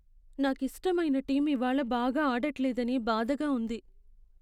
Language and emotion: Telugu, sad